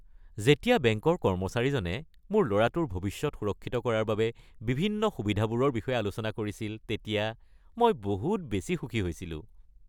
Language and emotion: Assamese, happy